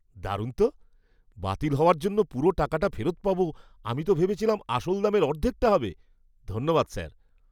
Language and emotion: Bengali, surprised